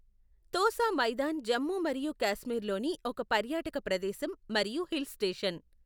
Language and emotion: Telugu, neutral